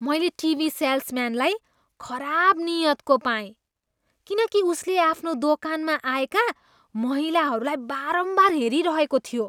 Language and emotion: Nepali, disgusted